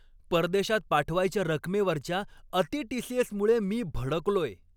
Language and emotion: Marathi, angry